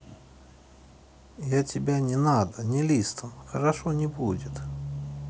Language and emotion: Russian, neutral